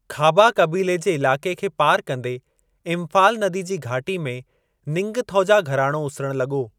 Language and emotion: Sindhi, neutral